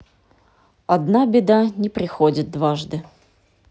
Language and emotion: Russian, neutral